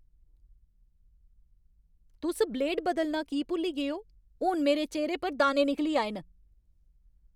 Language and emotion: Dogri, angry